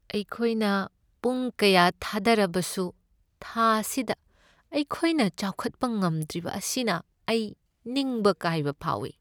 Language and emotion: Manipuri, sad